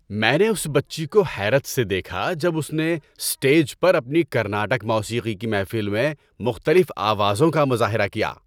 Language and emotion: Urdu, happy